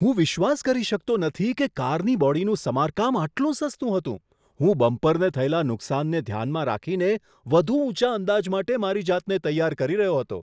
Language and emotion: Gujarati, surprised